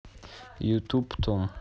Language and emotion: Russian, neutral